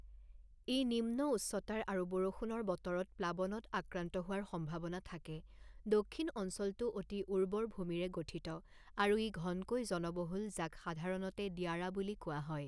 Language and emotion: Assamese, neutral